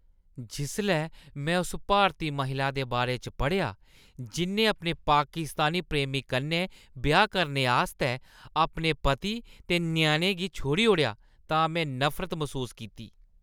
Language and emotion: Dogri, disgusted